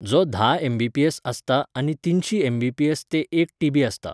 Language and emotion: Goan Konkani, neutral